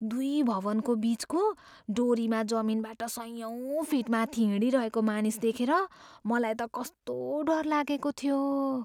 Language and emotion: Nepali, fearful